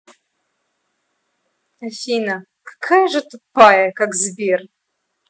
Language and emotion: Russian, angry